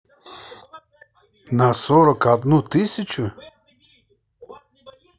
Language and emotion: Russian, neutral